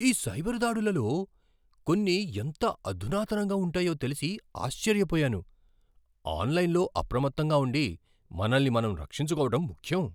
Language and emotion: Telugu, surprised